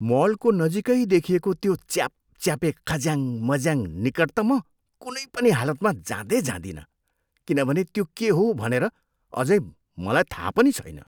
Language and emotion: Nepali, disgusted